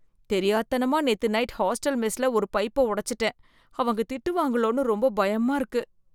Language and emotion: Tamil, fearful